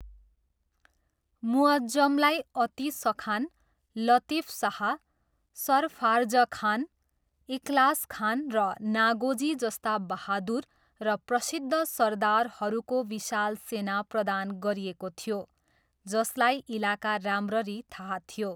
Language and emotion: Nepali, neutral